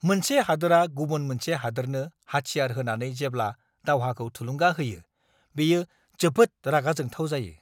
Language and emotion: Bodo, angry